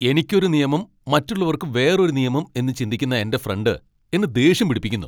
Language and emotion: Malayalam, angry